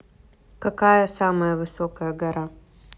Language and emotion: Russian, neutral